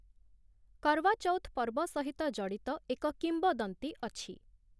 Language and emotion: Odia, neutral